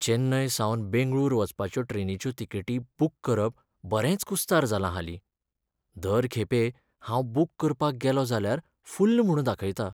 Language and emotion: Goan Konkani, sad